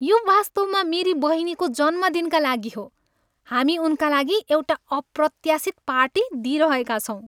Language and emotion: Nepali, happy